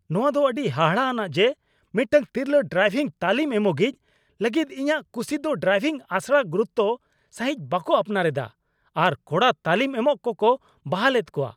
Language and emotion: Santali, angry